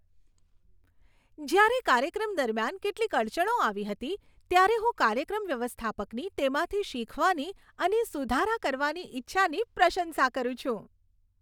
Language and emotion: Gujarati, happy